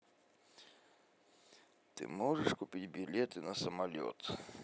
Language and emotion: Russian, neutral